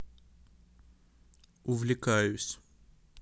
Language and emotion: Russian, neutral